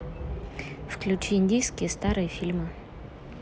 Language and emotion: Russian, neutral